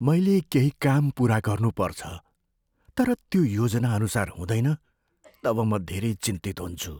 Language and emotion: Nepali, fearful